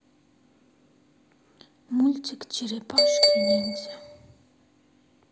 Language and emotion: Russian, sad